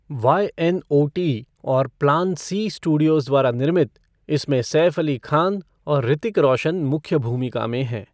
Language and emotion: Hindi, neutral